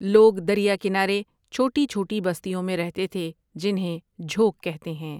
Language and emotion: Urdu, neutral